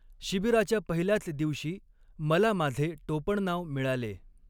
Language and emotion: Marathi, neutral